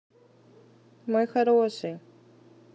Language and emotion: Russian, positive